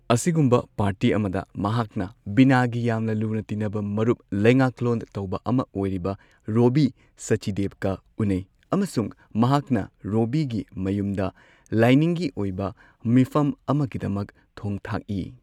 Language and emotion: Manipuri, neutral